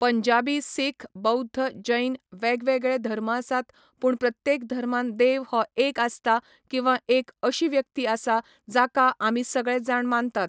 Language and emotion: Goan Konkani, neutral